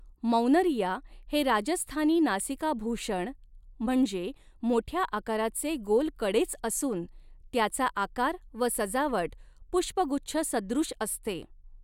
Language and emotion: Marathi, neutral